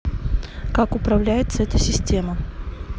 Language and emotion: Russian, neutral